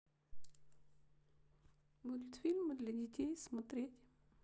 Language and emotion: Russian, sad